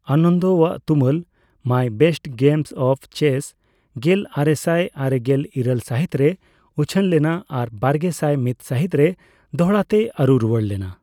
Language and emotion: Santali, neutral